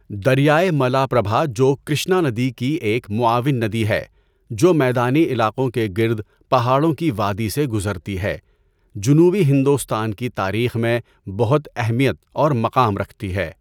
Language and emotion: Urdu, neutral